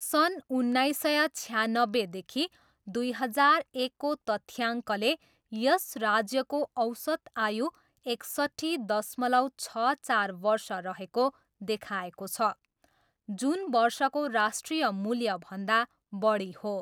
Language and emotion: Nepali, neutral